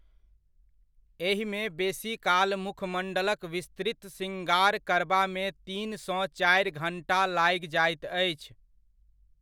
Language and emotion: Maithili, neutral